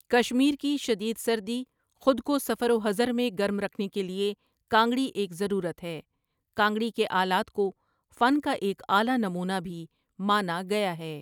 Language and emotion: Urdu, neutral